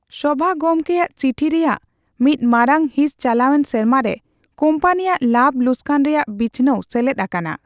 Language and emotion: Santali, neutral